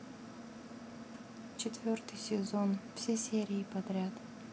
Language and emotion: Russian, neutral